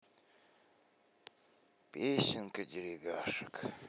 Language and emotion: Russian, sad